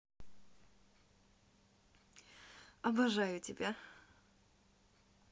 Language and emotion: Russian, positive